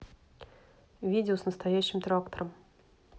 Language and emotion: Russian, neutral